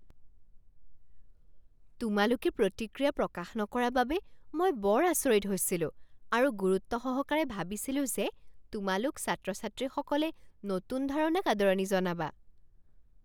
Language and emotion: Assamese, surprised